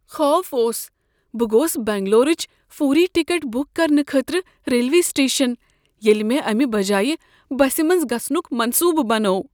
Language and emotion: Kashmiri, fearful